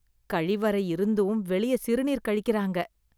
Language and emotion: Tamil, disgusted